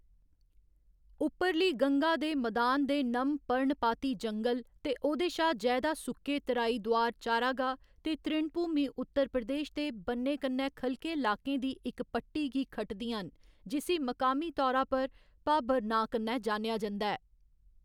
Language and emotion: Dogri, neutral